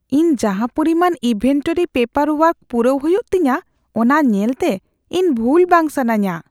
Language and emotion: Santali, fearful